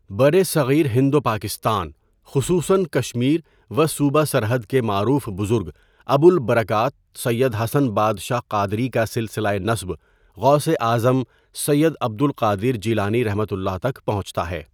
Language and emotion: Urdu, neutral